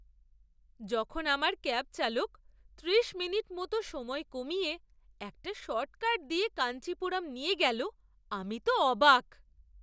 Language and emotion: Bengali, surprised